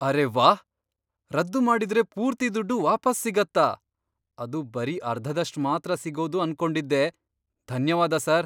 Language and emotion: Kannada, surprised